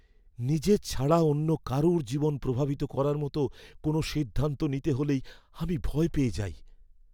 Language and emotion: Bengali, fearful